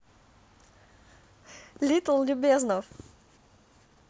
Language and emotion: Russian, positive